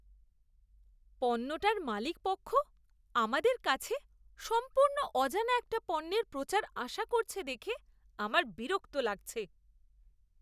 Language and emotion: Bengali, disgusted